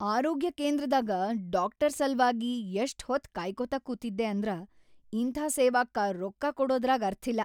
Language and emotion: Kannada, angry